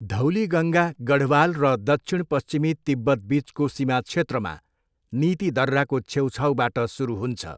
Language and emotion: Nepali, neutral